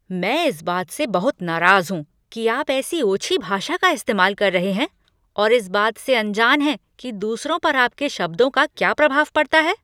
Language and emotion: Hindi, angry